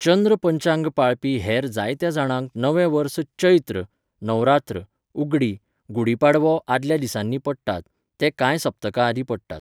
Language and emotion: Goan Konkani, neutral